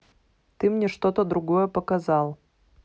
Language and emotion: Russian, neutral